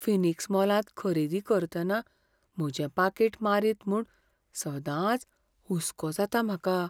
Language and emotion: Goan Konkani, fearful